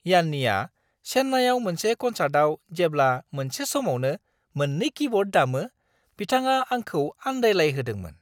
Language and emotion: Bodo, surprised